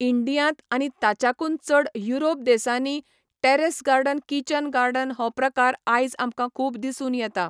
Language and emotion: Goan Konkani, neutral